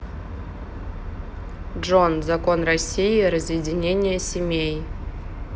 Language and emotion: Russian, neutral